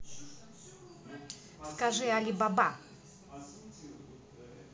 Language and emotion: Russian, positive